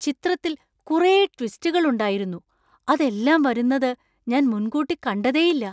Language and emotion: Malayalam, surprised